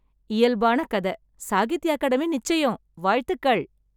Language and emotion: Tamil, happy